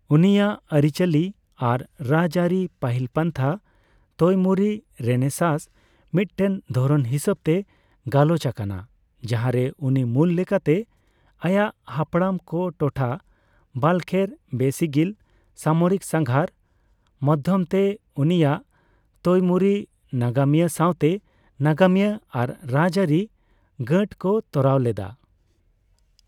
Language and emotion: Santali, neutral